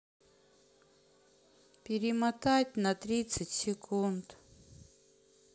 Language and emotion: Russian, sad